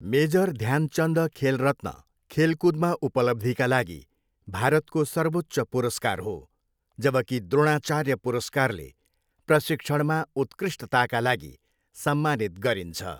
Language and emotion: Nepali, neutral